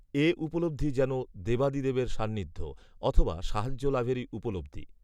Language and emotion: Bengali, neutral